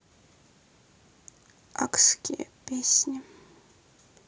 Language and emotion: Russian, sad